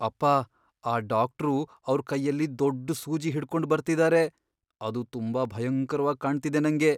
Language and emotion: Kannada, fearful